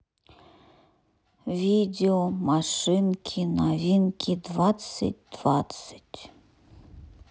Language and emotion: Russian, sad